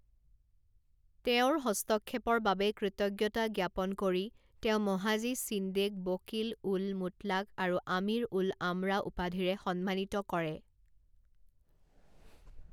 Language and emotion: Assamese, neutral